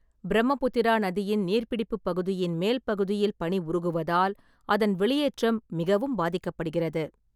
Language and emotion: Tamil, neutral